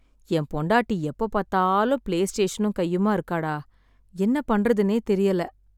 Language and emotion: Tamil, sad